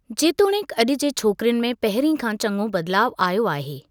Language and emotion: Sindhi, neutral